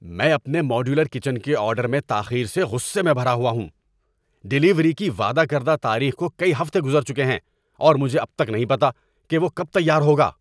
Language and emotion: Urdu, angry